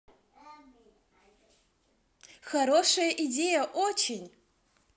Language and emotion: Russian, positive